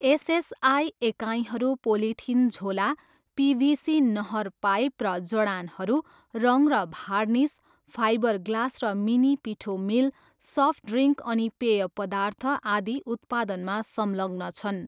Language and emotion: Nepali, neutral